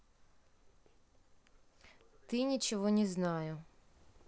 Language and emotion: Russian, neutral